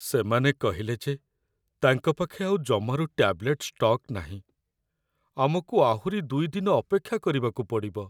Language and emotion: Odia, sad